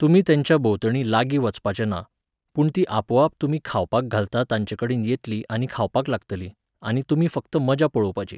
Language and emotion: Goan Konkani, neutral